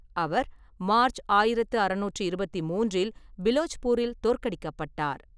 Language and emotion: Tamil, neutral